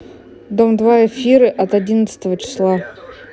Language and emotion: Russian, neutral